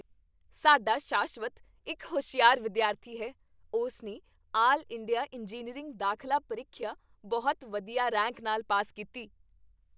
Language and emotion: Punjabi, happy